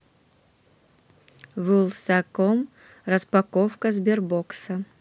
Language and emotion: Russian, neutral